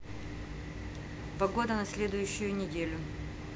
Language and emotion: Russian, neutral